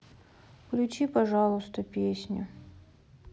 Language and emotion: Russian, sad